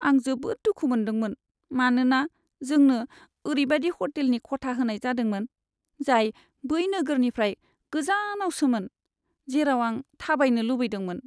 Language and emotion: Bodo, sad